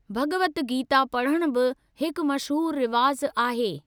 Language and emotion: Sindhi, neutral